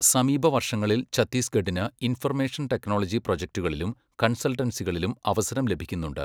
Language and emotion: Malayalam, neutral